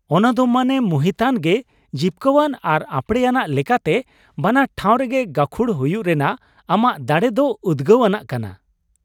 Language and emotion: Santali, happy